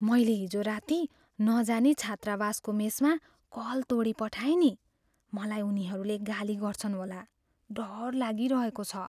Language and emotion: Nepali, fearful